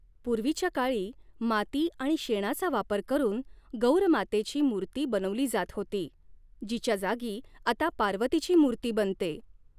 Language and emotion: Marathi, neutral